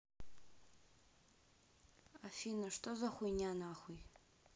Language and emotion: Russian, neutral